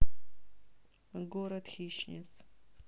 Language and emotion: Russian, neutral